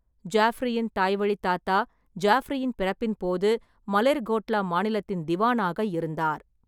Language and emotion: Tamil, neutral